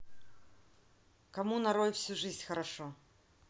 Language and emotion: Russian, neutral